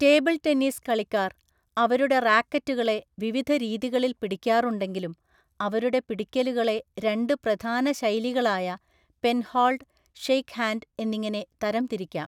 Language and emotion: Malayalam, neutral